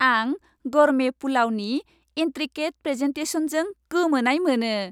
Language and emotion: Bodo, happy